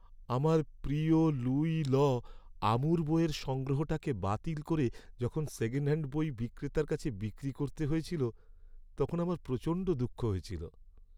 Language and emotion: Bengali, sad